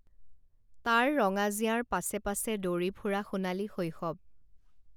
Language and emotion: Assamese, neutral